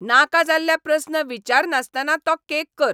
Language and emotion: Goan Konkani, angry